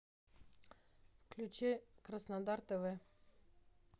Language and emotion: Russian, neutral